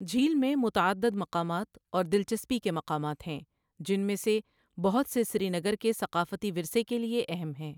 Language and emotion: Urdu, neutral